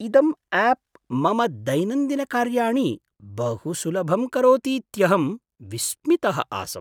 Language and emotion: Sanskrit, surprised